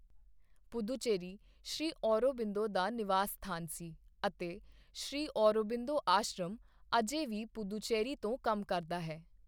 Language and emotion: Punjabi, neutral